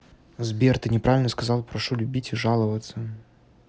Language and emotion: Russian, neutral